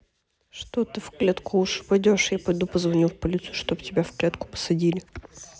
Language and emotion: Russian, neutral